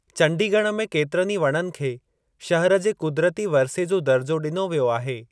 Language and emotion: Sindhi, neutral